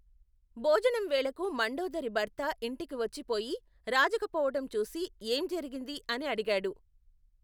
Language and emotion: Telugu, neutral